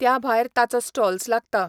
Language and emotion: Goan Konkani, neutral